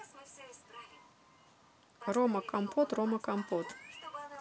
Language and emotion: Russian, neutral